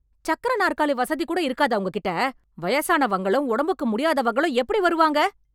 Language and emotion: Tamil, angry